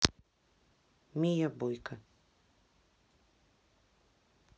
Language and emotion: Russian, neutral